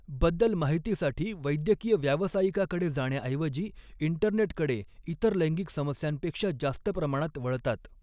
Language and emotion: Marathi, neutral